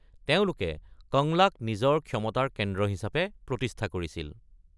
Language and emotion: Assamese, neutral